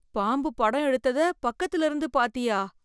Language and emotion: Tamil, fearful